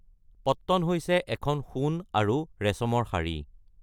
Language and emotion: Assamese, neutral